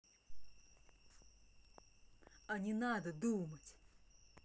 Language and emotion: Russian, angry